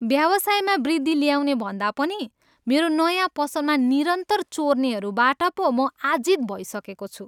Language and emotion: Nepali, disgusted